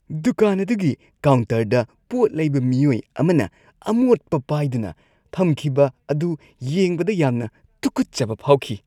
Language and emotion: Manipuri, disgusted